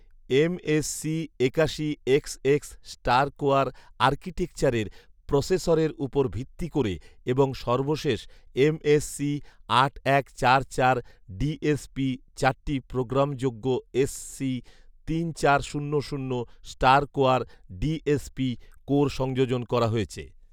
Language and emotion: Bengali, neutral